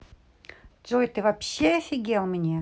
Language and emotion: Russian, angry